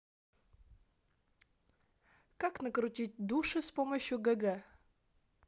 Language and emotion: Russian, neutral